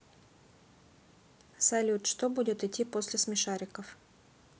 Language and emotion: Russian, neutral